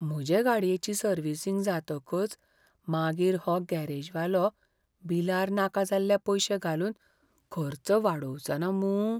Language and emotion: Goan Konkani, fearful